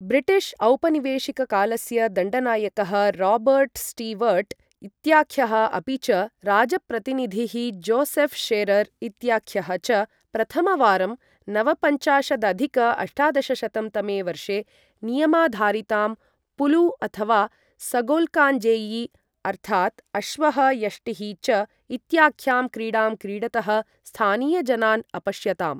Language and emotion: Sanskrit, neutral